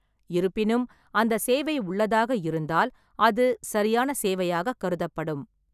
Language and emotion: Tamil, neutral